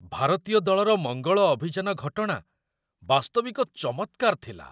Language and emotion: Odia, surprised